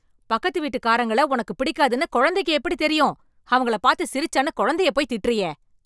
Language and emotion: Tamil, angry